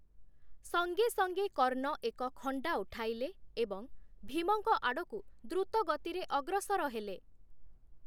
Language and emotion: Odia, neutral